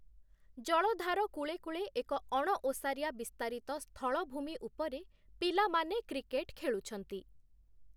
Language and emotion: Odia, neutral